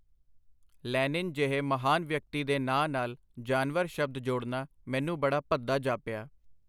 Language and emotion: Punjabi, neutral